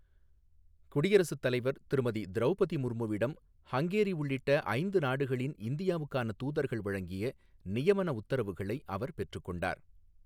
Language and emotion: Tamil, neutral